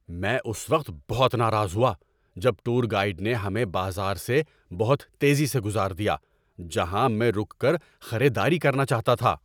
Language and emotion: Urdu, angry